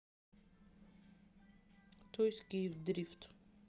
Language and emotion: Russian, neutral